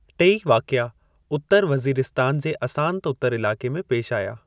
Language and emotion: Sindhi, neutral